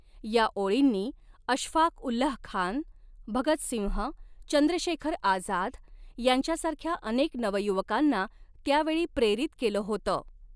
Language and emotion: Marathi, neutral